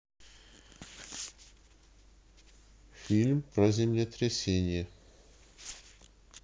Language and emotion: Russian, neutral